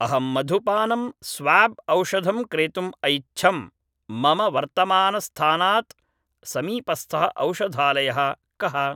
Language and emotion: Sanskrit, neutral